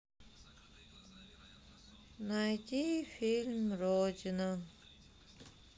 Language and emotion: Russian, sad